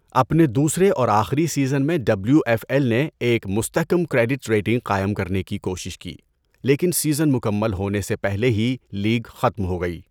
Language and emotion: Urdu, neutral